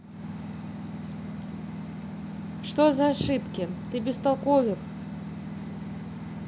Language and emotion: Russian, neutral